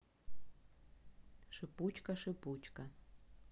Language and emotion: Russian, neutral